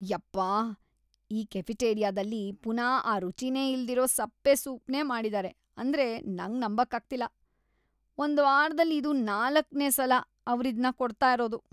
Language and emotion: Kannada, disgusted